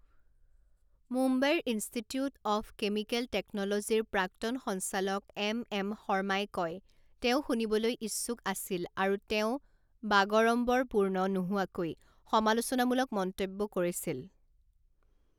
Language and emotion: Assamese, neutral